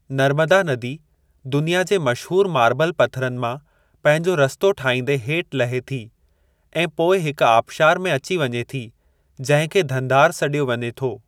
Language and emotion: Sindhi, neutral